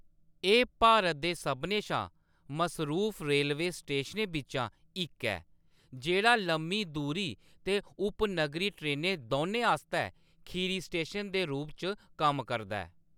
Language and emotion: Dogri, neutral